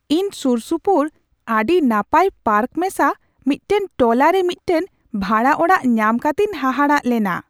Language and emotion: Santali, surprised